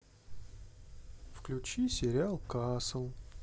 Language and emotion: Russian, sad